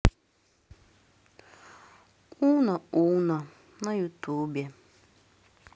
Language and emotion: Russian, sad